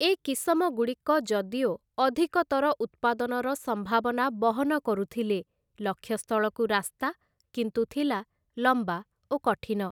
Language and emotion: Odia, neutral